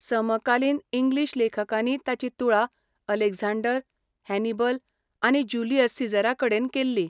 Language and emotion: Goan Konkani, neutral